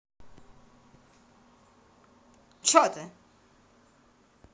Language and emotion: Russian, angry